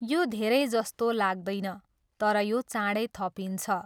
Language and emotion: Nepali, neutral